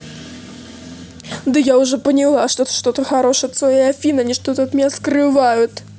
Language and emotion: Russian, angry